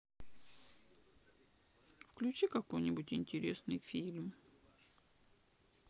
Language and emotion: Russian, sad